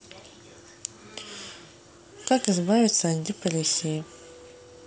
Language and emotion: Russian, neutral